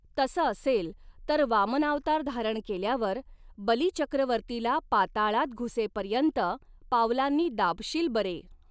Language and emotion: Marathi, neutral